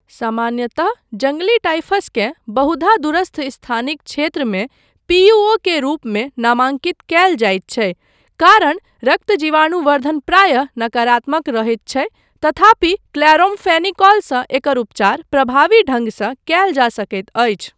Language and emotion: Maithili, neutral